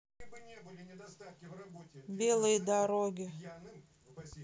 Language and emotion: Russian, neutral